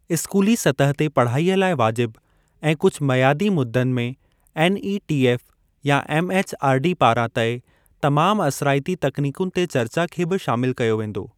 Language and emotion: Sindhi, neutral